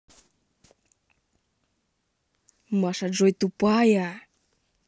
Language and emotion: Russian, angry